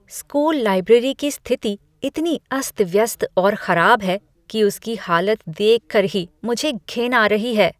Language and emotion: Hindi, disgusted